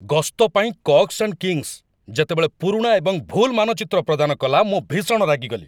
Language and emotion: Odia, angry